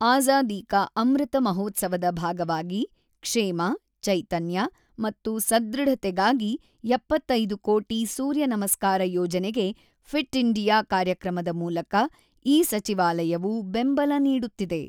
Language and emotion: Kannada, neutral